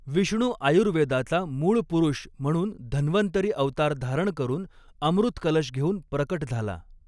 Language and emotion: Marathi, neutral